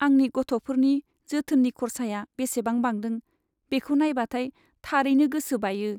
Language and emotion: Bodo, sad